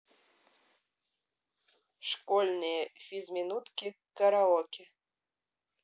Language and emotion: Russian, neutral